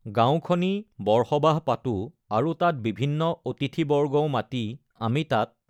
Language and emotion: Assamese, neutral